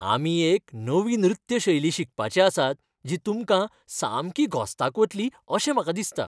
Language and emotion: Goan Konkani, happy